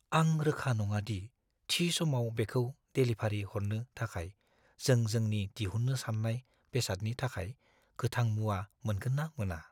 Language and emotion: Bodo, fearful